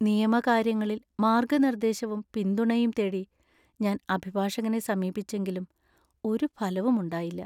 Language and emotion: Malayalam, sad